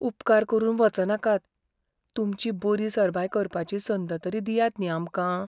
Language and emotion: Goan Konkani, fearful